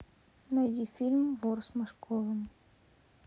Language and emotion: Russian, neutral